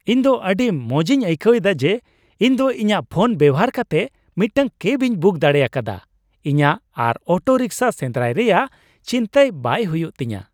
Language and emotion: Santali, happy